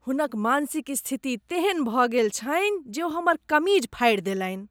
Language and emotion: Maithili, disgusted